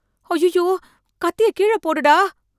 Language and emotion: Tamil, fearful